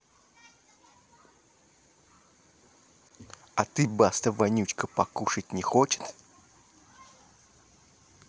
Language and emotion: Russian, angry